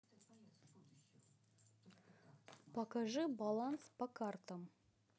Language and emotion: Russian, neutral